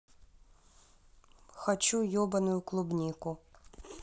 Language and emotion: Russian, neutral